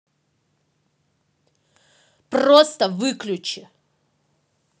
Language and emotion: Russian, angry